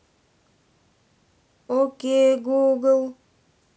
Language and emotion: Russian, neutral